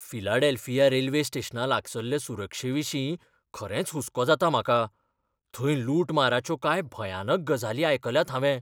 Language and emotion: Goan Konkani, fearful